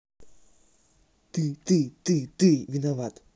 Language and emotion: Russian, angry